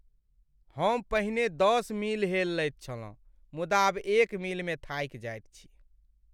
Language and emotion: Maithili, sad